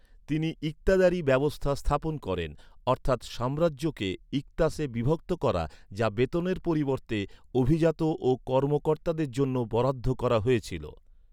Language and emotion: Bengali, neutral